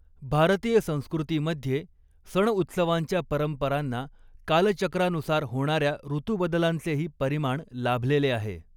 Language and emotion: Marathi, neutral